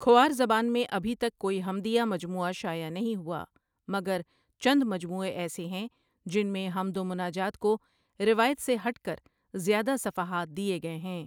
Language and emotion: Urdu, neutral